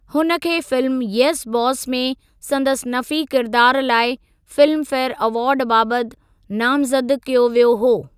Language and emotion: Sindhi, neutral